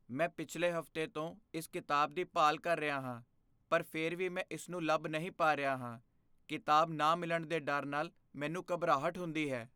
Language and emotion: Punjabi, fearful